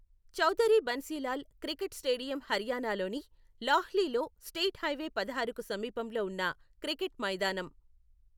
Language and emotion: Telugu, neutral